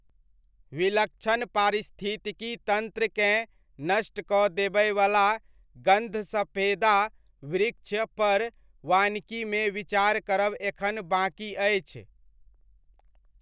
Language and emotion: Maithili, neutral